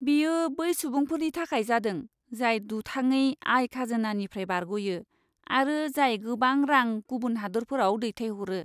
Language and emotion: Bodo, disgusted